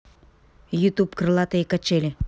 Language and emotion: Russian, neutral